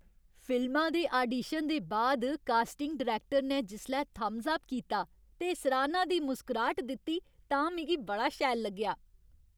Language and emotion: Dogri, happy